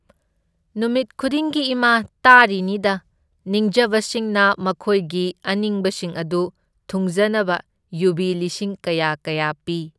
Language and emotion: Manipuri, neutral